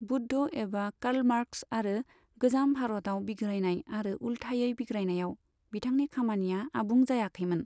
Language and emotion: Bodo, neutral